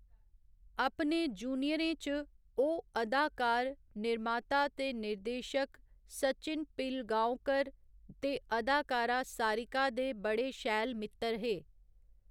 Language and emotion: Dogri, neutral